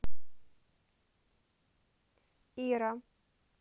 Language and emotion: Russian, neutral